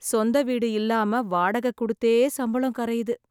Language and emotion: Tamil, sad